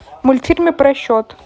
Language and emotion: Russian, neutral